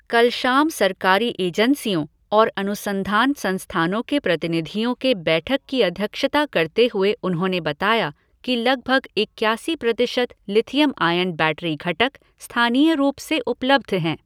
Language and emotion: Hindi, neutral